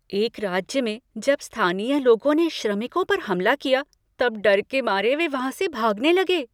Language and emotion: Hindi, fearful